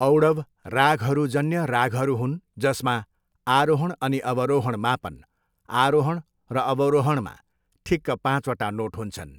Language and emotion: Nepali, neutral